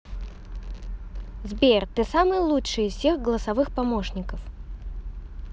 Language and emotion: Russian, positive